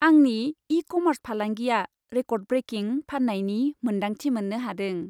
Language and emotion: Bodo, happy